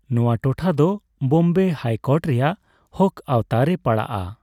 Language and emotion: Santali, neutral